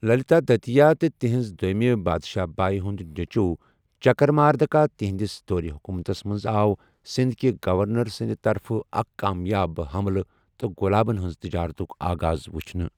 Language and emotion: Kashmiri, neutral